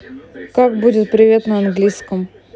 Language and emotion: Russian, neutral